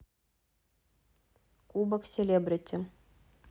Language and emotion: Russian, neutral